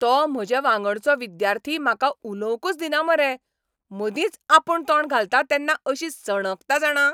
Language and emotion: Goan Konkani, angry